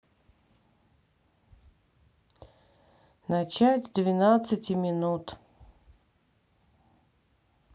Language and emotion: Russian, sad